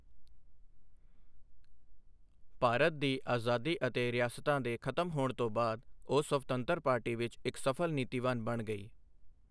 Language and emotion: Punjabi, neutral